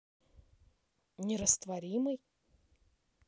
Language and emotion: Russian, neutral